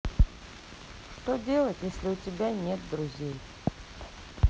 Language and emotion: Russian, sad